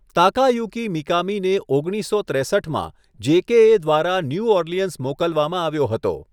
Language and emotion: Gujarati, neutral